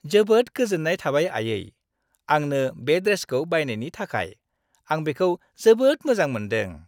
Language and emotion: Bodo, happy